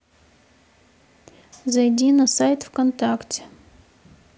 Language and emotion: Russian, neutral